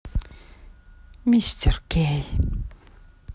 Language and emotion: Russian, neutral